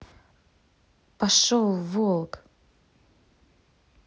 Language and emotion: Russian, angry